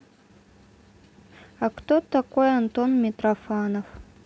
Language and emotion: Russian, neutral